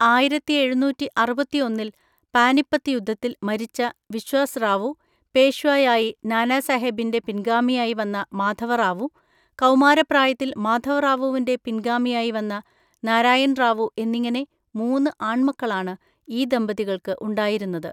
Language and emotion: Malayalam, neutral